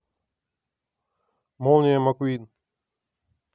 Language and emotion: Russian, neutral